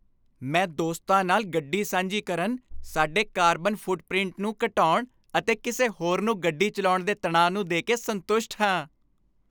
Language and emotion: Punjabi, happy